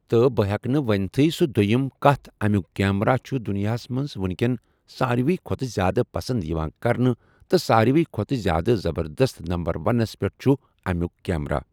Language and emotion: Kashmiri, neutral